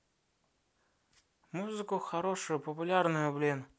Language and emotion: Russian, neutral